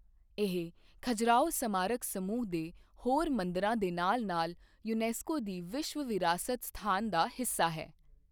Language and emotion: Punjabi, neutral